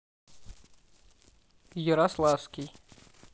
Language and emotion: Russian, neutral